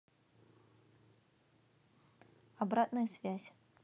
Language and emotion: Russian, neutral